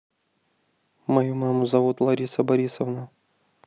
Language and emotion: Russian, neutral